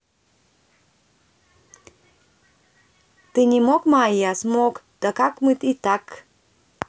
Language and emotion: Russian, neutral